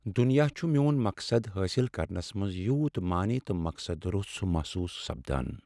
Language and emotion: Kashmiri, sad